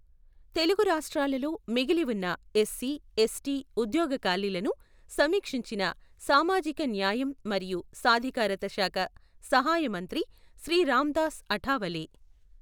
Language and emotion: Telugu, neutral